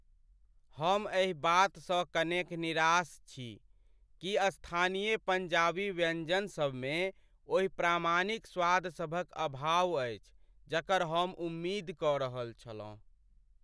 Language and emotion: Maithili, sad